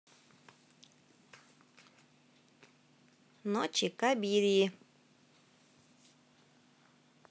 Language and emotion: Russian, neutral